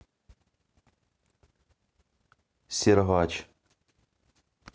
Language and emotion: Russian, neutral